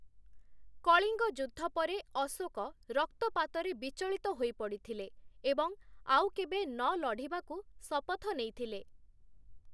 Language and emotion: Odia, neutral